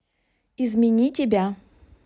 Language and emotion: Russian, neutral